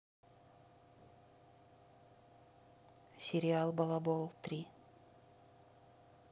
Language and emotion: Russian, neutral